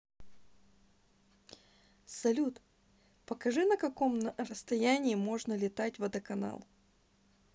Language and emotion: Russian, neutral